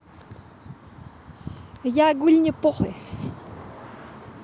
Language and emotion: Russian, positive